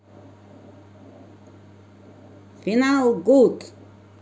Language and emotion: Russian, positive